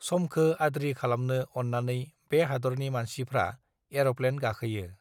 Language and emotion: Bodo, neutral